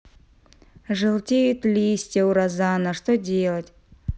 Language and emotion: Russian, sad